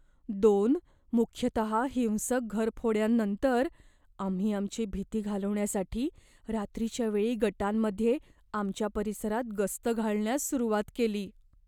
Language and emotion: Marathi, fearful